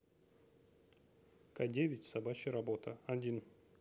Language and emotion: Russian, neutral